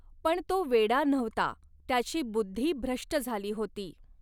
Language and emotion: Marathi, neutral